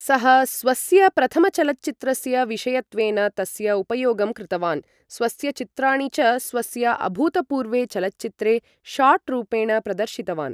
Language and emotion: Sanskrit, neutral